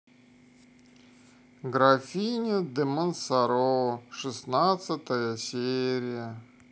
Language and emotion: Russian, sad